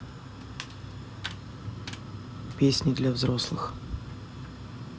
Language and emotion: Russian, neutral